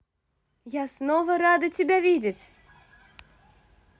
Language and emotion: Russian, positive